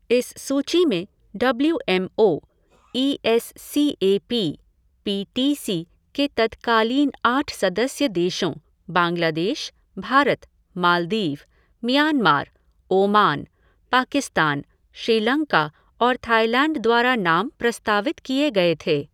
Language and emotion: Hindi, neutral